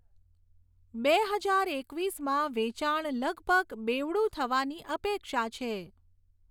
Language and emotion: Gujarati, neutral